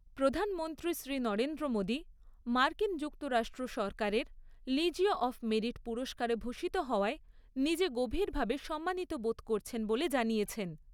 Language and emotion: Bengali, neutral